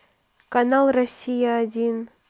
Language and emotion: Russian, neutral